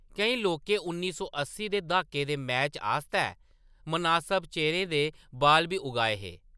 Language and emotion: Dogri, neutral